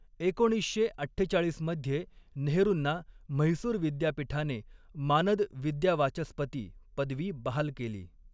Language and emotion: Marathi, neutral